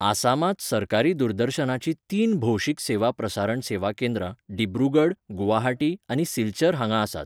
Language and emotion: Goan Konkani, neutral